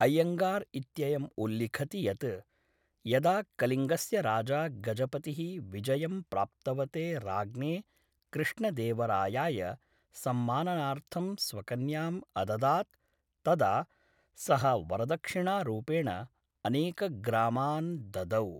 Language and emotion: Sanskrit, neutral